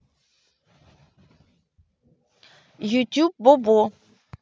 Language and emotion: Russian, neutral